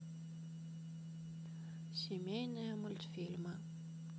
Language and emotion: Russian, sad